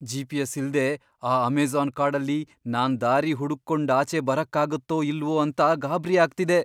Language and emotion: Kannada, fearful